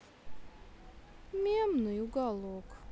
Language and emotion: Russian, sad